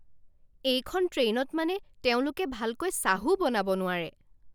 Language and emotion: Assamese, angry